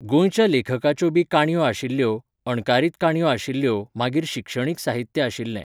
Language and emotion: Goan Konkani, neutral